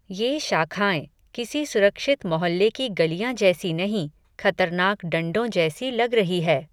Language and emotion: Hindi, neutral